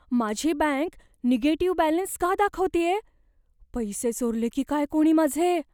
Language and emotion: Marathi, fearful